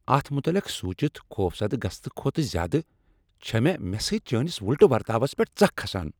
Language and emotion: Kashmiri, angry